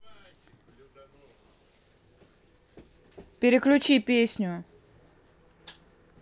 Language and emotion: Russian, angry